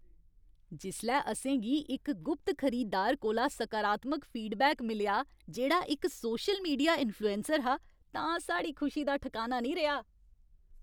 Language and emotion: Dogri, happy